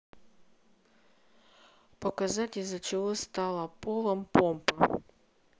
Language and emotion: Russian, neutral